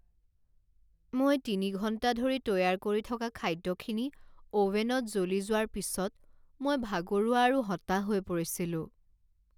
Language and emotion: Assamese, sad